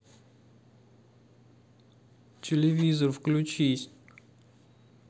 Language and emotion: Russian, sad